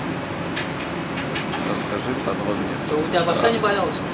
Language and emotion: Russian, neutral